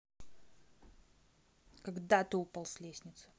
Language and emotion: Russian, angry